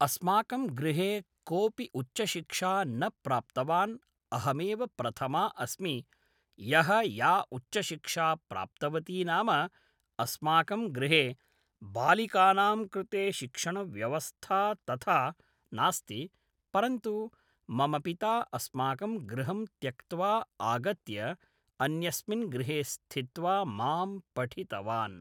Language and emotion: Sanskrit, neutral